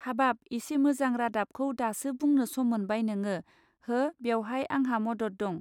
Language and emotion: Bodo, neutral